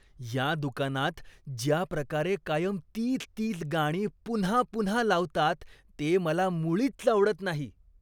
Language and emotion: Marathi, disgusted